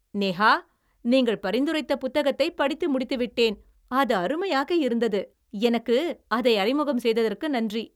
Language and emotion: Tamil, happy